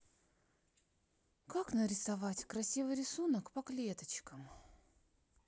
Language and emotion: Russian, sad